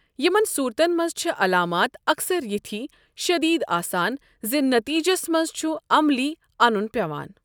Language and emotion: Kashmiri, neutral